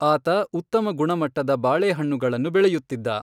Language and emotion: Kannada, neutral